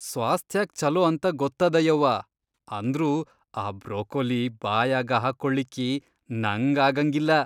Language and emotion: Kannada, disgusted